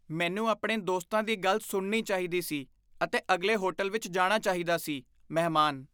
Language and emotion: Punjabi, disgusted